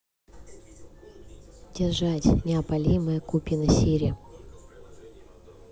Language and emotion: Russian, neutral